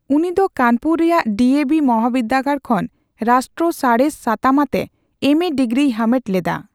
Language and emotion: Santali, neutral